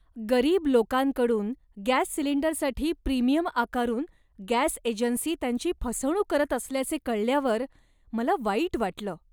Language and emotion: Marathi, disgusted